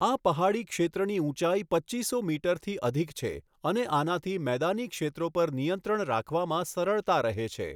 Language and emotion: Gujarati, neutral